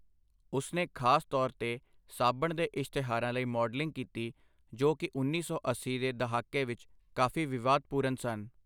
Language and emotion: Punjabi, neutral